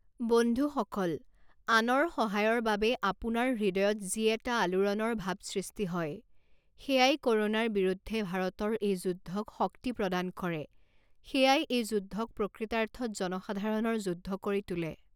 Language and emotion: Assamese, neutral